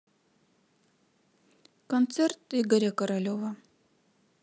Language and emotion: Russian, neutral